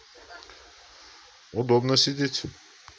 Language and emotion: Russian, neutral